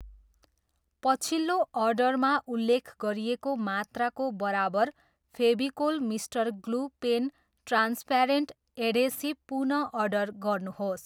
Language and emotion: Nepali, neutral